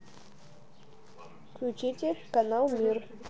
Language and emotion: Russian, neutral